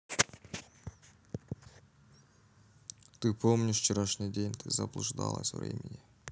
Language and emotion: Russian, neutral